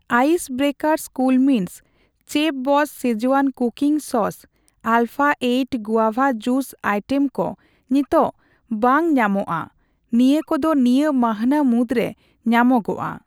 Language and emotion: Santali, neutral